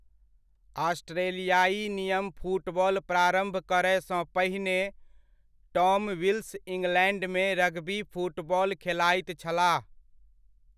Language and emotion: Maithili, neutral